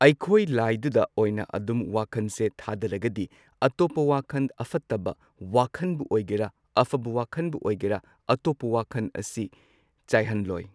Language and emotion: Manipuri, neutral